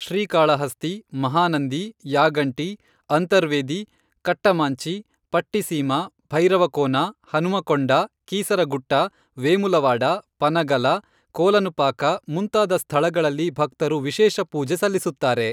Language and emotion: Kannada, neutral